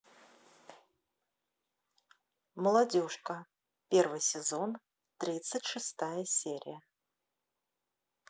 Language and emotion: Russian, neutral